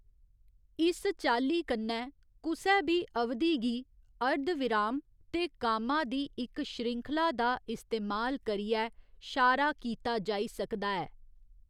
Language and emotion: Dogri, neutral